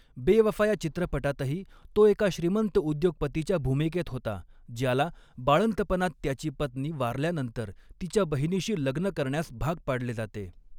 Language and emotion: Marathi, neutral